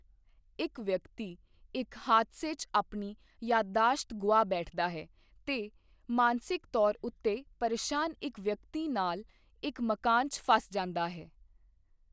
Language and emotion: Punjabi, neutral